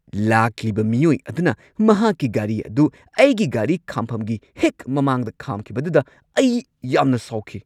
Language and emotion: Manipuri, angry